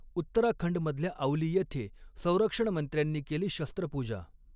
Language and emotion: Marathi, neutral